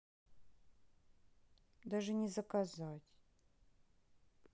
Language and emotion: Russian, sad